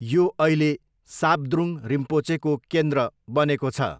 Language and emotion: Nepali, neutral